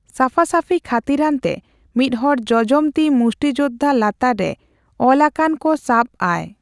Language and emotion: Santali, neutral